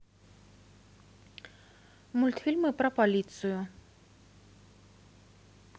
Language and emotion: Russian, neutral